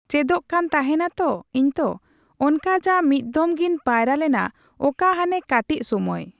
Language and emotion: Santali, neutral